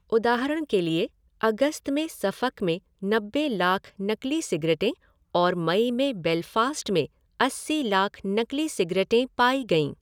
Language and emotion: Hindi, neutral